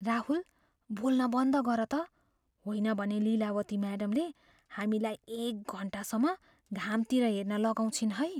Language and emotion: Nepali, fearful